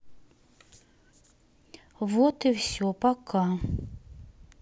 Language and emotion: Russian, neutral